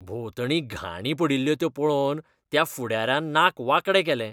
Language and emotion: Goan Konkani, disgusted